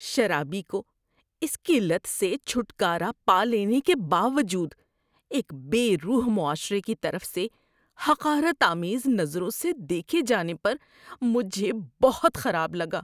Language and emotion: Urdu, disgusted